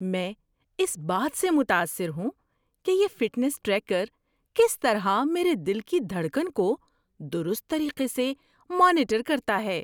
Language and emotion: Urdu, surprised